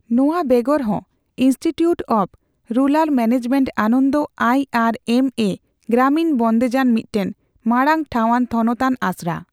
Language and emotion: Santali, neutral